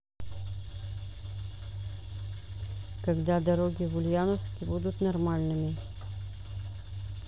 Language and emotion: Russian, neutral